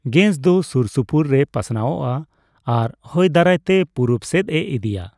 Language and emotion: Santali, neutral